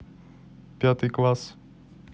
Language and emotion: Russian, neutral